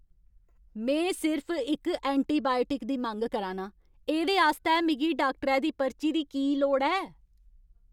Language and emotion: Dogri, angry